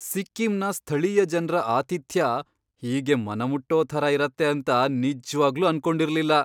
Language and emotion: Kannada, surprised